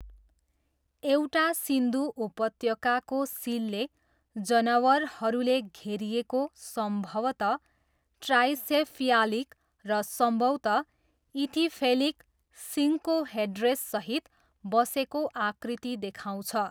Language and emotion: Nepali, neutral